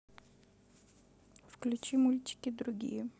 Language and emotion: Russian, neutral